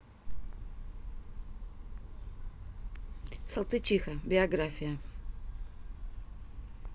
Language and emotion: Russian, neutral